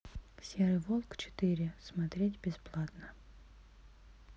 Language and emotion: Russian, neutral